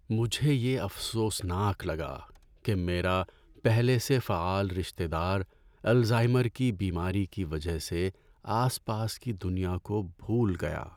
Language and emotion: Urdu, sad